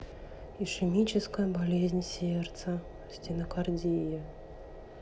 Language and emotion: Russian, sad